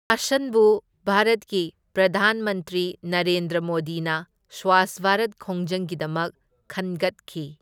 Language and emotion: Manipuri, neutral